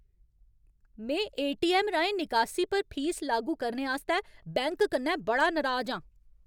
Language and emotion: Dogri, angry